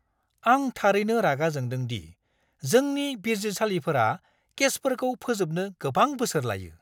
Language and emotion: Bodo, angry